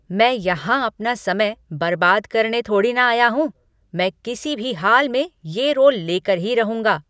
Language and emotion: Hindi, angry